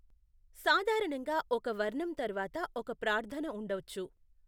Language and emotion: Telugu, neutral